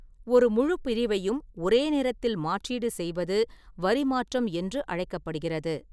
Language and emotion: Tamil, neutral